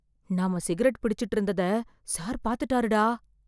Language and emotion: Tamil, fearful